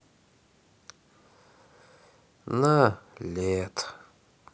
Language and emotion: Russian, sad